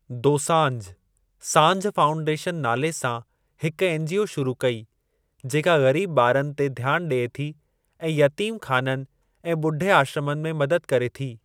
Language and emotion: Sindhi, neutral